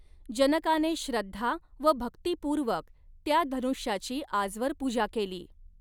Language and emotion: Marathi, neutral